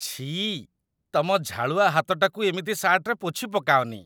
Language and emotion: Odia, disgusted